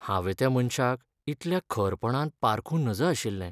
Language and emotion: Goan Konkani, sad